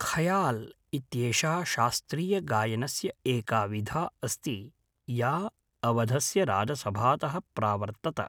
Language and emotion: Sanskrit, neutral